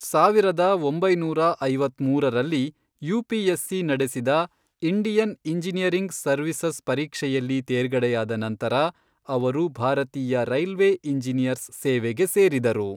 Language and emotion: Kannada, neutral